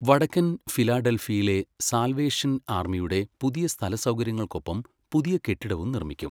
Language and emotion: Malayalam, neutral